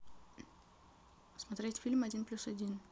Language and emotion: Russian, neutral